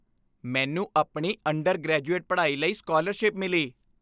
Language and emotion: Punjabi, happy